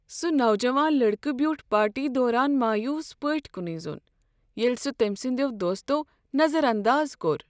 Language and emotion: Kashmiri, sad